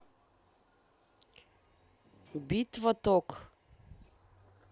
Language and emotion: Russian, neutral